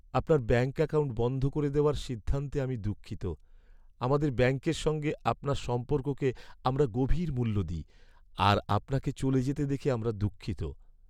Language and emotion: Bengali, sad